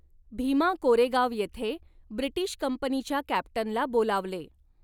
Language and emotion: Marathi, neutral